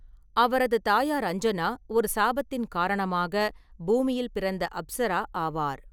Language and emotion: Tamil, neutral